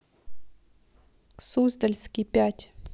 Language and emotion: Russian, neutral